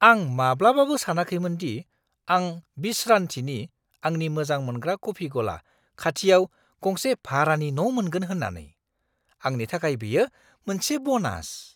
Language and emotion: Bodo, surprised